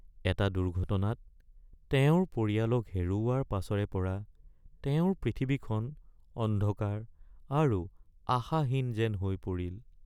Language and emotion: Assamese, sad